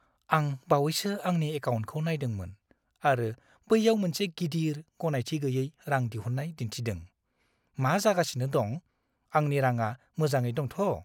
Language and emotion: Bodo, fearful